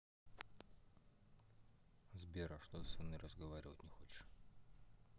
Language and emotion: Russian, neutral